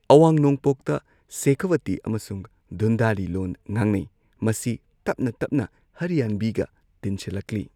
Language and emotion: Manipuri, neutral